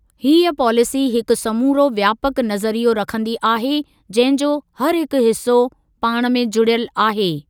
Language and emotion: Sindhi, neutral